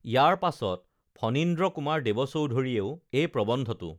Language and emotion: Assamese, neutral